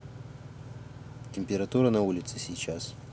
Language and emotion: Russian, neutral